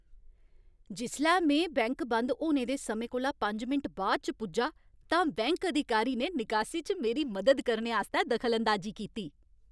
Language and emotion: Dogri, happy